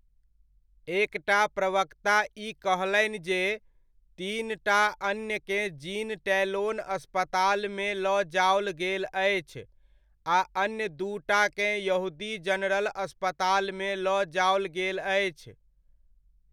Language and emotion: Maithili, neutral